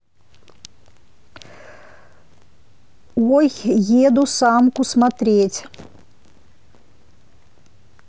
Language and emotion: Russian, neutral